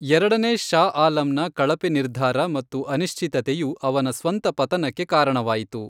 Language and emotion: Kannada, neutral